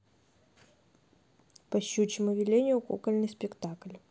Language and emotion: Russian, neutral